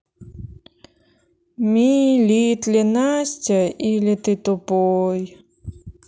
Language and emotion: Russian, sad